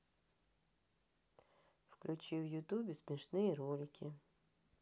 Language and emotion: Russian, neutral